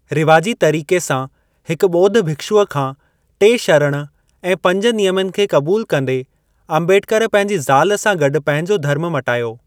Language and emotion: Sindhi, neutral